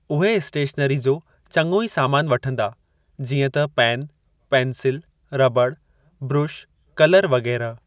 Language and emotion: Sindhi, neutral